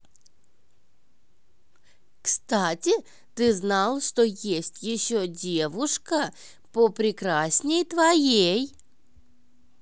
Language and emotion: Russian, positive